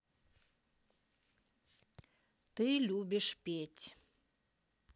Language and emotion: Russian, neutral